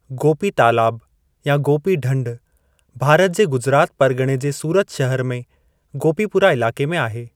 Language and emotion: Sindhi, neutral